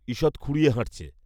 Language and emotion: Bengali, neutral